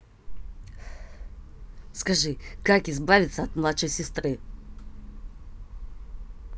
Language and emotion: Russian, angry